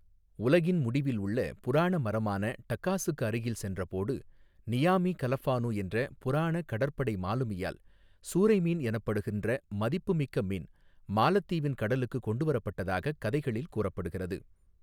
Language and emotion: Tamil, neutral